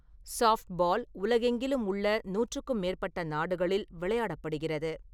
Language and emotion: Tamil, neutral